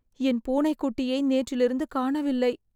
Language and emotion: Tamil, sad